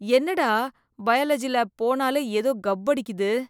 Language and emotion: Tamil, disgusted